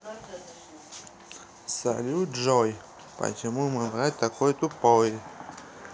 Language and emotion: Russian, neutral